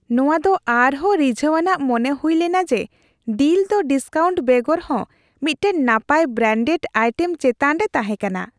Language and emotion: Santali, happy